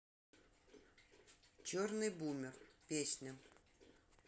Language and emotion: Russian, neutral